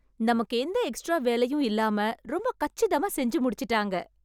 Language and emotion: Tamil, happy